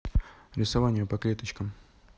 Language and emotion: Russian, neutral